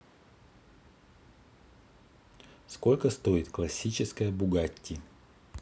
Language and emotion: Russian, neutral